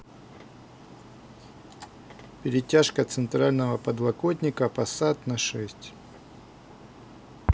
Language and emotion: Russian, neutral